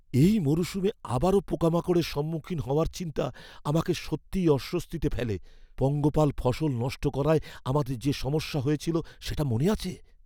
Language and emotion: Bengali, fearful